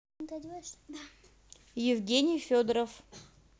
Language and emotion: Russian, neutral